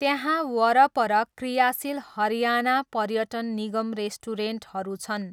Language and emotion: Nepali, neutral